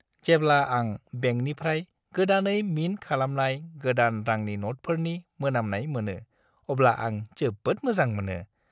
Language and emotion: Bodo, happy